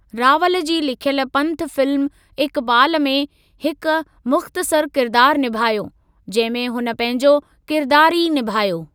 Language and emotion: Sindhi, neutral